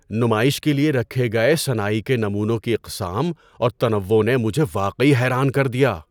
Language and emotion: Urdu, surprised